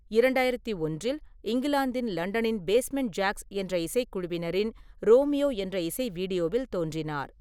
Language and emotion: Tamil, neutral